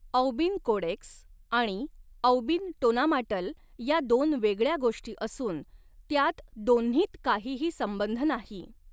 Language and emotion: Marathi, neutral